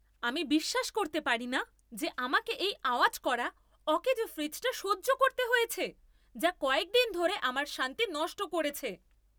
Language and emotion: Bengali, angry